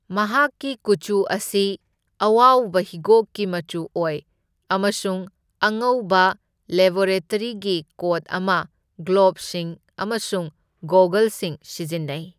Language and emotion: Manipuri, neutral